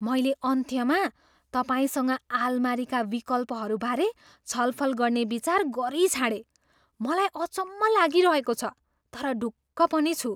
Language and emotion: Nepali, surprised